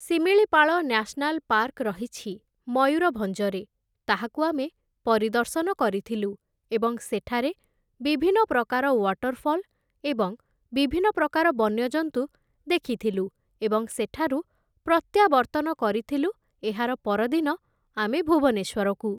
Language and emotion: Odia, neutral